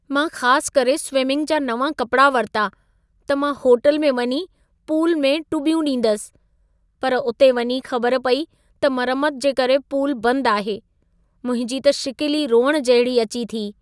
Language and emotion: Sindhi, sad